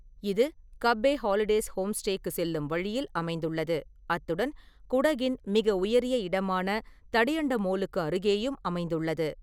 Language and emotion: Tamil, neutral